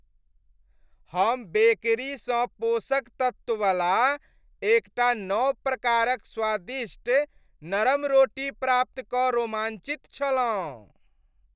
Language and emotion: Maithili, happy